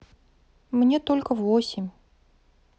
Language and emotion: Russian, sad